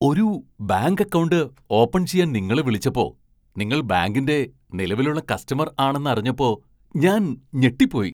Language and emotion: Malayalam, surprised